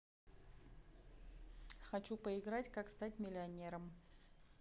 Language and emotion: Russian, neutral